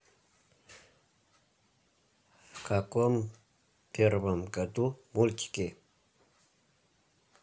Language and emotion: Russian, neutral